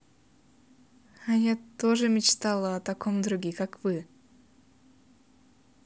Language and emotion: Russian, positive